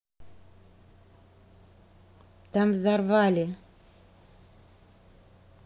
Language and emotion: Russian, neutral